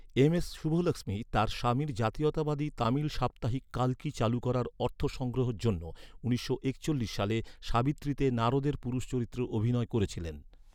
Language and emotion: Bengali, neutral